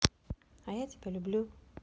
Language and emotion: Russian, positive